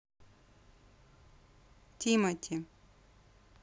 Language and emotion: Russian, neutral